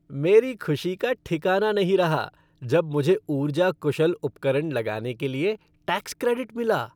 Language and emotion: Hindi, happy